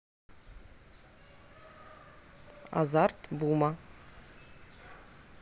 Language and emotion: Russian, neutral